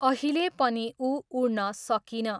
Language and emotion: Nepali, neutral